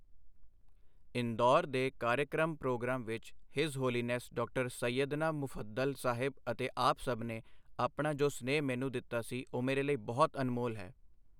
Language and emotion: Punjabi, neutral